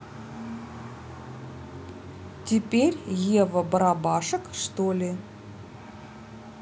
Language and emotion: Russian, neutral